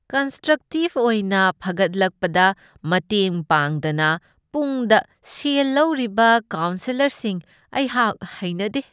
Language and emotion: Manipuri, disgusted